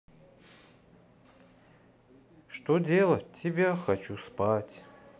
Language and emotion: Russian, sad